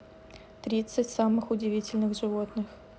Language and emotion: Russian, neutral